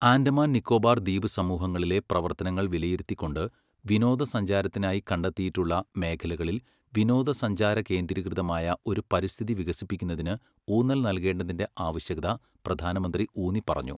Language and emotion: Malayalam, neutral